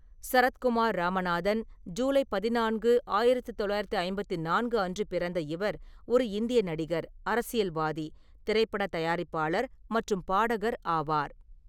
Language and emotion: Tamil, neutral